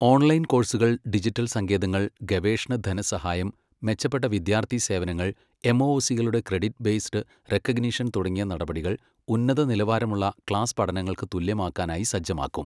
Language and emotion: Malayalam, neutral